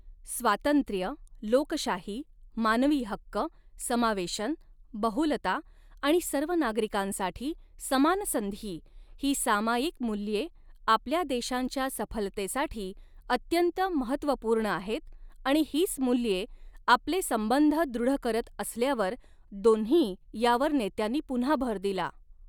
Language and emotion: Marathi, neutral